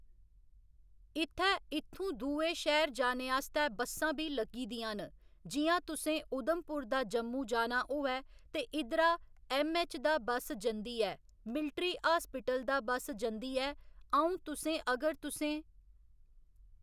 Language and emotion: Dogri, neutral